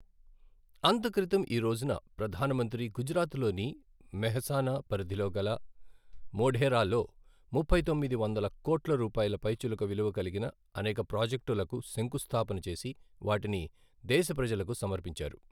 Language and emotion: Telugu, neutral